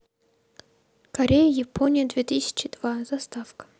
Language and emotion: Russian, neutral